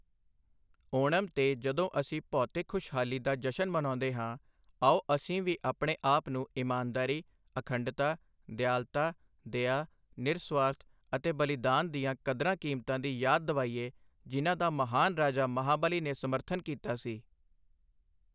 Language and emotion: Punjabi, neutral